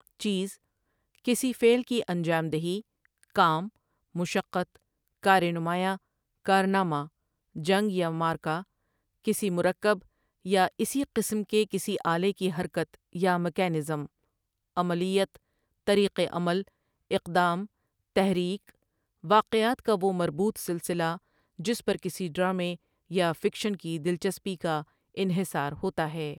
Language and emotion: Urdu, neutral